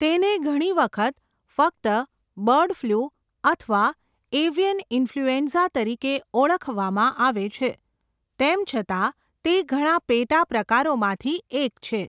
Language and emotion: Gujarati, neutral